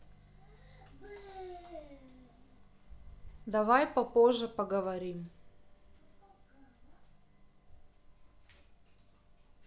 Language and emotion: Russian, neutral